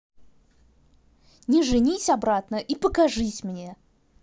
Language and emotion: Russian, angry